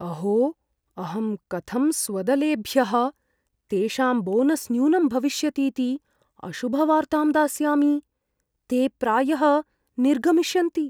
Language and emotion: Sanskrit, fearful